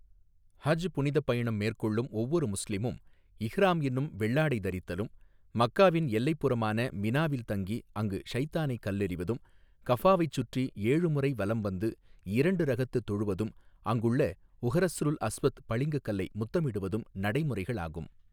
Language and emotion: Tamil, neutral